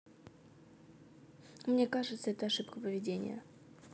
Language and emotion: Russian, neutral